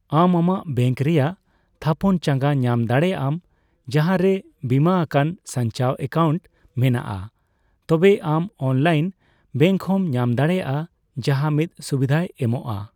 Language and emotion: Santali, neutral